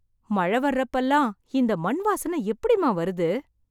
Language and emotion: Tamil, surprised